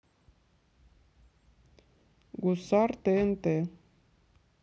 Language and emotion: Russian, neutral